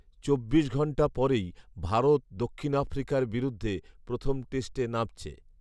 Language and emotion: Bengali, neutral